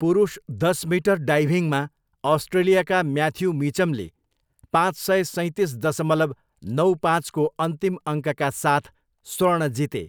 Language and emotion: Nepali, neutral